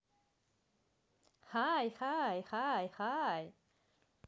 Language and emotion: Russian, positive